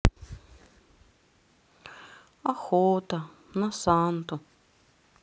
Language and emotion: Russian, sad